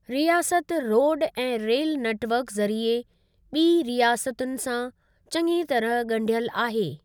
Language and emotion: Sindhi, neutral